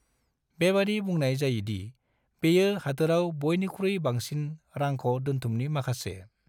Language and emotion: Bodo, neutral